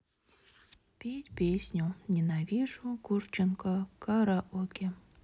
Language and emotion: Russian, sad